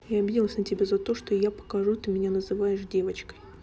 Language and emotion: Russian, neutral